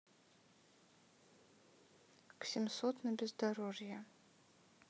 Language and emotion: Russian, neutral